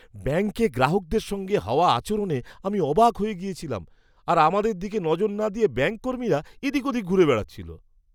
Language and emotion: Bengali, disgusted